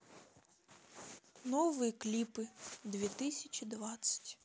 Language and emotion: Russian, neutral